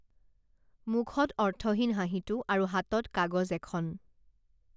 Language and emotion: Assamese, neutral